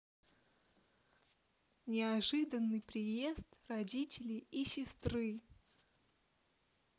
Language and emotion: Russian, neutral